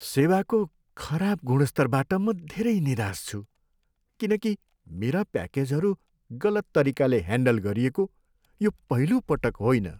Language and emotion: Nepali, sad